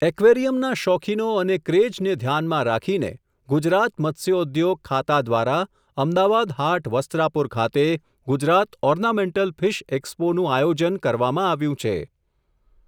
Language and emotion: Gujarati, neutral